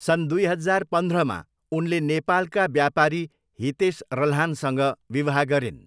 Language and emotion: Nepali, neutral